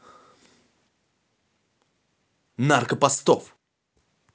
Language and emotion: Russian, angry